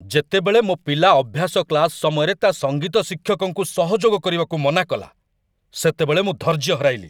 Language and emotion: Odia, angry